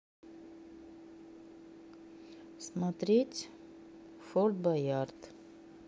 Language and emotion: Russian, neutral